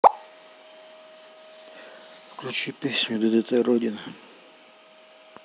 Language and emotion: Russian, neutral